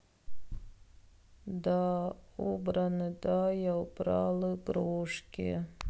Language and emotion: Russian, sad